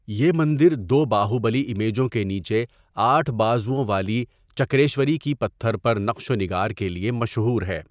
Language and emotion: Urdu, neutral